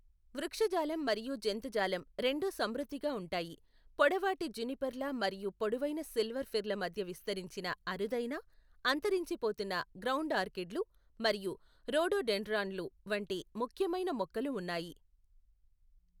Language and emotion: Telugu, neutral